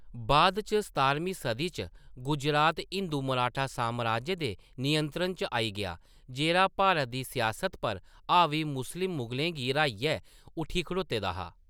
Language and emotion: Dogri, neutral